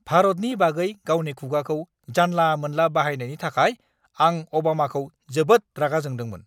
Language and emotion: Bodo, angry